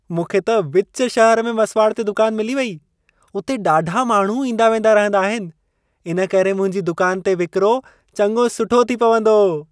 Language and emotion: Sindhi, happy